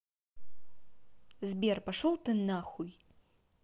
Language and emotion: Russian, angry